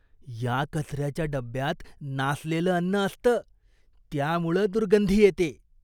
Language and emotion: Marathi, disgusted